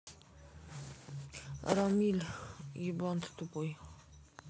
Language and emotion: Russian, sad